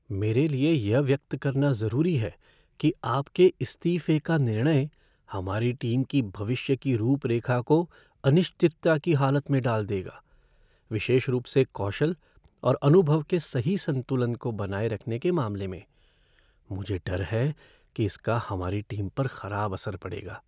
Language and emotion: Hindi, fearful